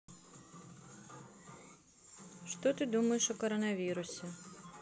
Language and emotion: Russian, neutral